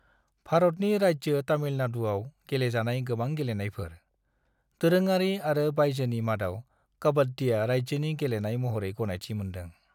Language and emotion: Bodo, neutral